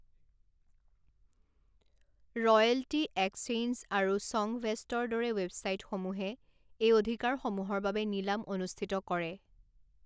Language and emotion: Assamese, neutral